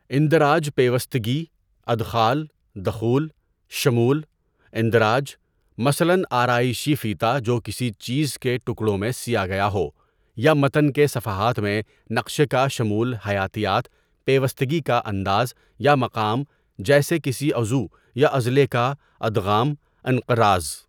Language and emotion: Urdu, neutral